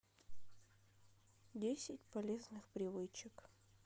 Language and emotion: Russian, sad